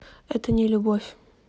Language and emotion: Russian, neutral